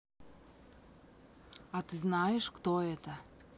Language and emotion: Russian, neutral